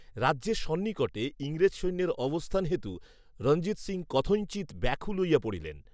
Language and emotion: Bengali, neutral